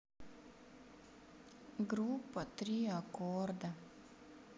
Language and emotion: Russian, sad